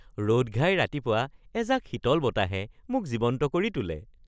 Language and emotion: Assamese, happy